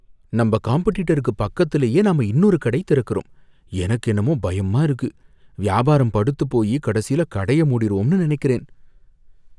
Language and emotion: Tamil, fearful